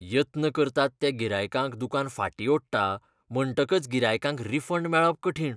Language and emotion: Goan Konkani, disgusted